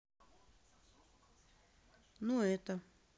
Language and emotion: Russian, neutral